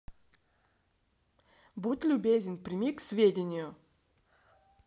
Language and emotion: Russian, neutral